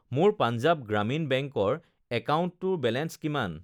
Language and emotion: Assamese, neutral